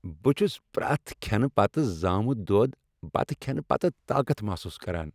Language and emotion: Kashmiri, happy